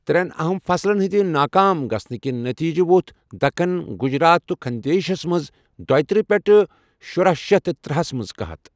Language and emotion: Kashmiri, neutral